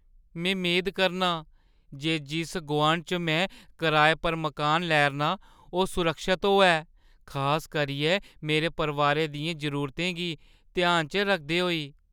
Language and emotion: Dogri, fearful